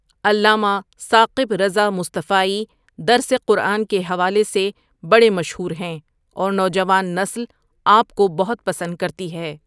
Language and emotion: Urdu, neutral